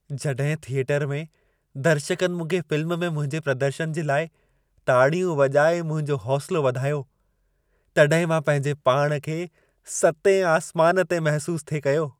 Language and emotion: Sindhi, happy